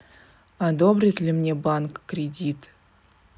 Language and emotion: Russian, neutral